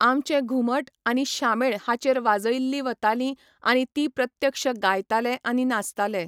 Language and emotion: Goan Konkani, neutral